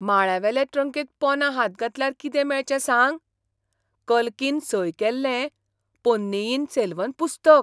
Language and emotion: Goan Konkani, surprised